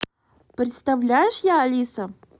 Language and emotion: Russian, positive